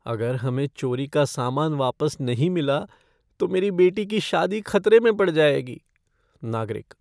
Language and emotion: Hindi, fearful